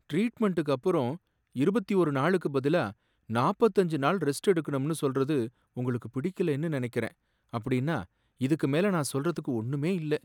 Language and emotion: Tamil, sad